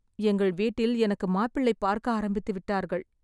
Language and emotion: Tamil, sad